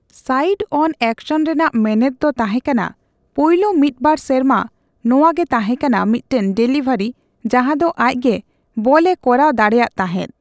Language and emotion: Santali, neutral